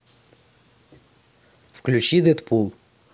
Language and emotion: Russian, neutral